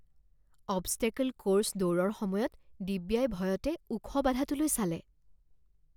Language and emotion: Assamese, fearful